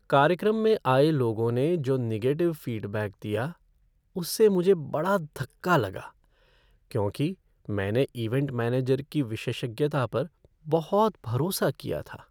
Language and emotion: Hindi, sad